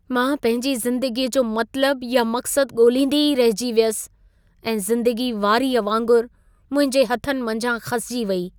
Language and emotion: Sindhi, sad